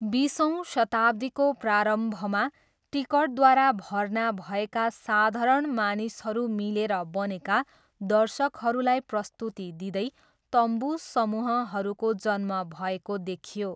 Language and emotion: Nepali, neutral